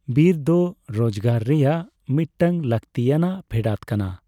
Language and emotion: Santali, neutral